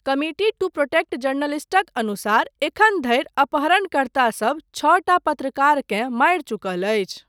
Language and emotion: Maithili, neutral